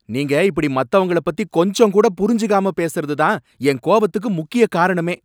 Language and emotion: Tamil, angry